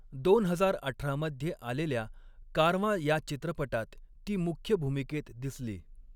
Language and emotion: Marathi, neutral